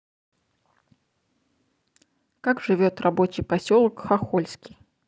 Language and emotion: Russian, neutral